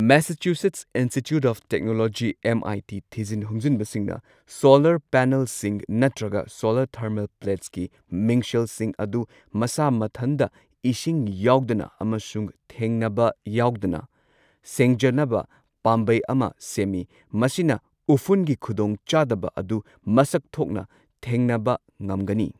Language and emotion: Manipuri, neutral